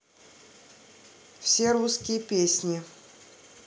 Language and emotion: Russian, neutral